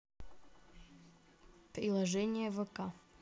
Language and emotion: Russian, neutral